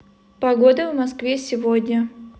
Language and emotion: Russian, neutral